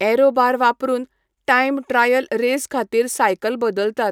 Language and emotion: Goan Konkani, neutral